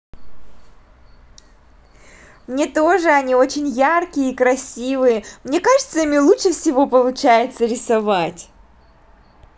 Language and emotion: Russian, positive